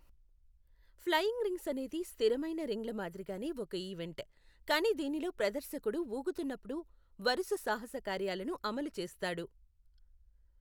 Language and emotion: Telugu, neutral